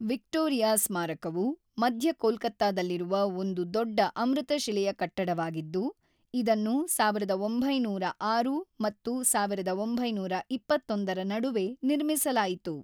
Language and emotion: Kannada, neutral